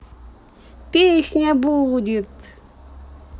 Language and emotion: Russian, positive